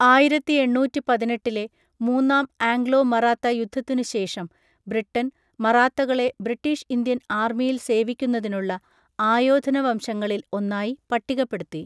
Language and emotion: Malayalam, neutral